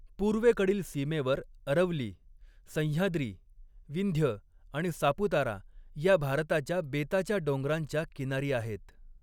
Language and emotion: Marathi, neutral